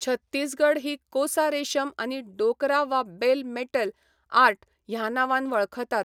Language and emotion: Goan Konkani, neutral